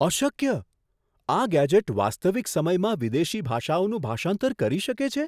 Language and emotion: Gujarati, surprised